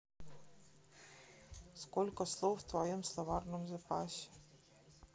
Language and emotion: Russian, neutral